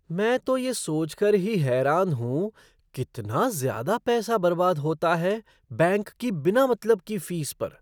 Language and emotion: Hindi, surprised